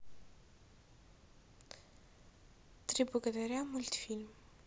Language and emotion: Russian, neutral